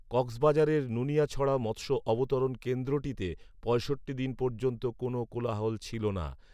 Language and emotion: Bengali, neutral